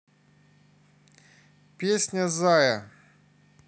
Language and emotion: Russian, neutral